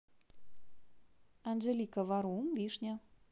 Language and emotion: Russian, neutral